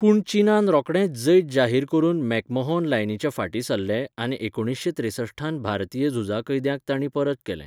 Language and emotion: Goan Konkani, neutral